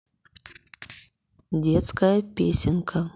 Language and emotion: Russian, neutral